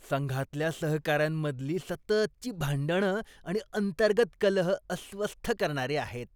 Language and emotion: Marathi, disgusted